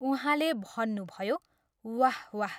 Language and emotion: Nepali, neutral